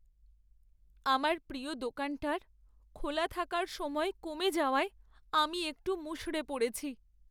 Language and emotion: Bengali, sad